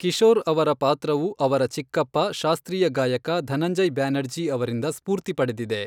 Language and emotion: Kannada, neutral